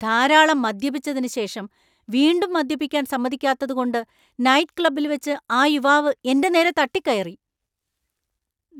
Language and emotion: Malayalam, angry